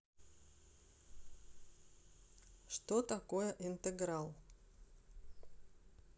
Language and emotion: Russian, neutral